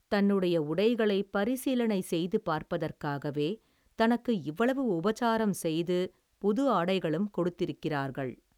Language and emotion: Tamil, neutral